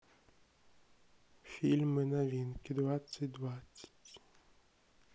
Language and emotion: Russian, neutral